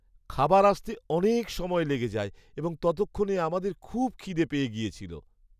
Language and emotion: Bengali, sad